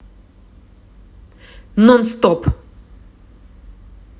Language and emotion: Russian, neutral